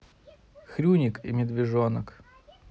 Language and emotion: Russian, neutral